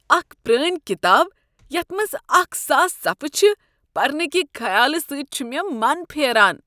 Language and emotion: Kashmiri, disgusted